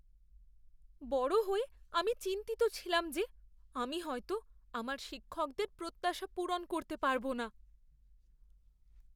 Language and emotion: Bengali, fearful